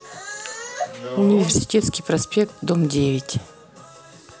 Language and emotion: Russian, neutral